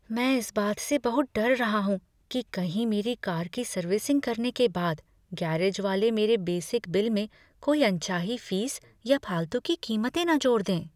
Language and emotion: Hindi, fearful